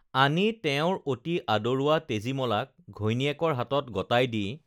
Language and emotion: Assamese, neutral